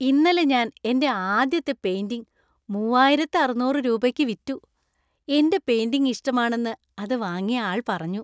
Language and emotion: Malayalam, happy